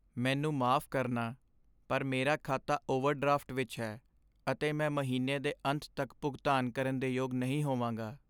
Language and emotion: Punjabi, sad